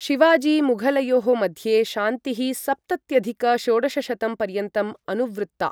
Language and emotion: Sanskrit, neutral